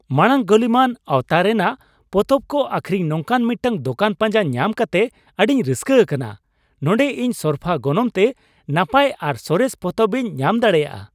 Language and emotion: Santali, happy